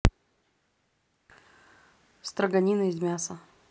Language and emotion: Russian, neutral